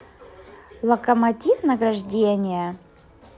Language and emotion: Russian, positive